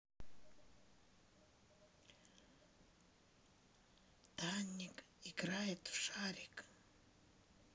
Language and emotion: Russian, neutral